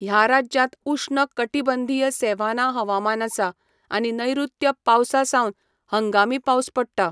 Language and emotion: Goan Konkani, neutral